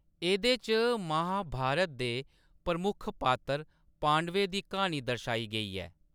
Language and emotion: Dogri, neutral